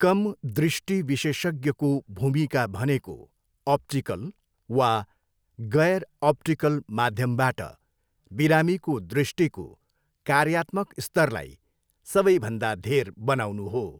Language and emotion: Nepali, neutral